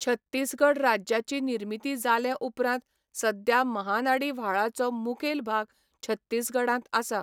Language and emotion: Goan Konkani, neutral